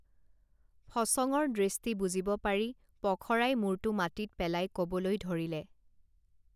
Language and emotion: Assamese, neutral